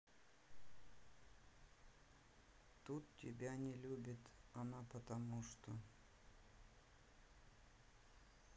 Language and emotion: Russian, neutral